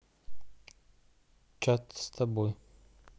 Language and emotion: Russian, neutral